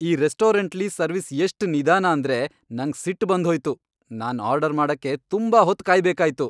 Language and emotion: Kannada, angry